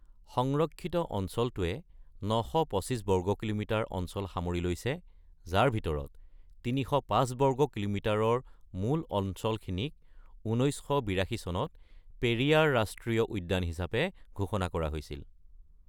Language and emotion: Assamese, neutral